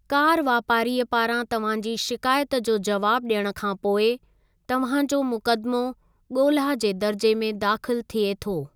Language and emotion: Sindhi, neutral